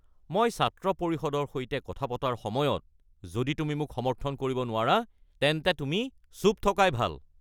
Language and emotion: Assamese, angry